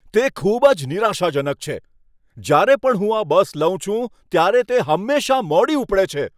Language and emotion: Gujarati, angry